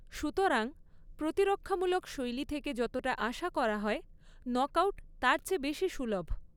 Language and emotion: Bengali, neutral